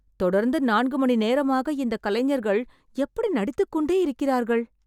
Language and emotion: Tamil, surprised